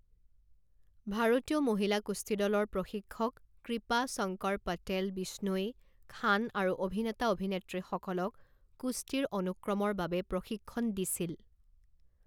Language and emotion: Assamese, neutral